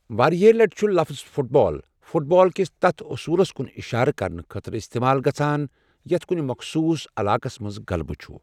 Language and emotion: Kashmiri, neutral